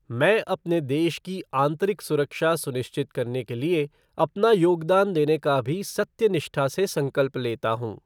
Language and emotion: Hindi, neutral